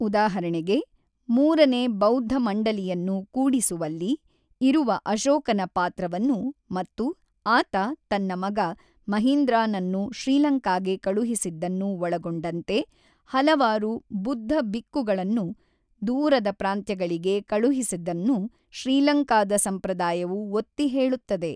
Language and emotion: Kannada, neutral